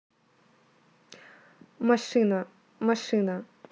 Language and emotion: Russian, neutral